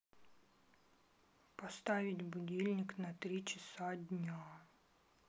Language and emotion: Russian, sad